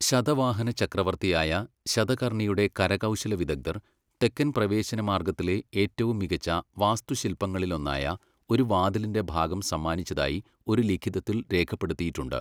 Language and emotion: Malayalam, neutral